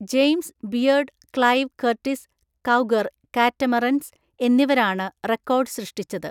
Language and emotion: Malayalam, neutral